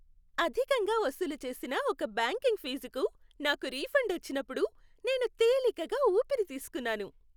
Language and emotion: Telugu, happy